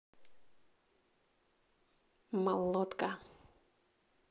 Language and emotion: Russian, positive